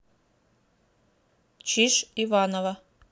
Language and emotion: Russian, neutral